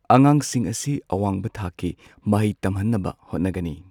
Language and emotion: Manipuri, neutral